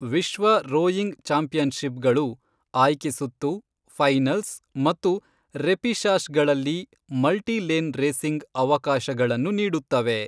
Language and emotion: Kannada, neutral